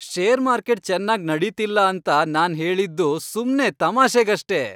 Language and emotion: Kannada, happy